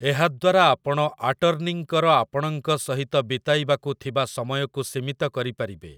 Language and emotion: Odia, neutral